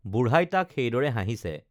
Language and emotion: Assamese, neutral